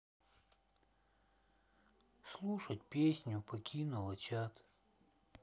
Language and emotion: Russian, sad